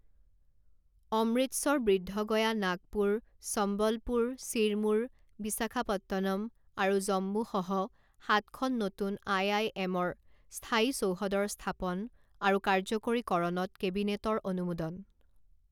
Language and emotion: Assamese, neutral